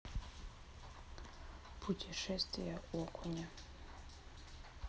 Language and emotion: Russian, neutral